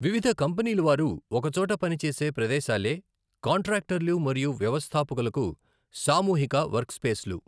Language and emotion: Telugu, neutral